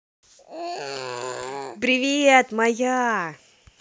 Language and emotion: Russian, positive